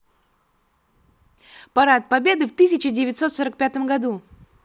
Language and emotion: Russian, positive